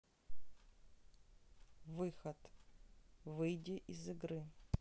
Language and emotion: Russian, neutral